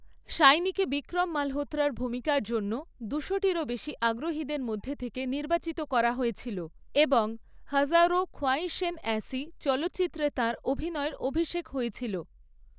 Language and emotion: Bengali, neutral